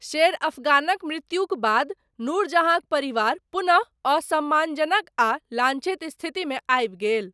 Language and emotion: Maithili, neutral